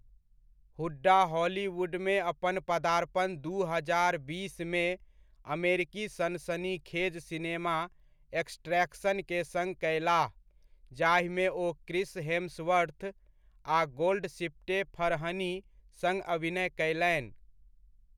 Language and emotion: Maithili, neutral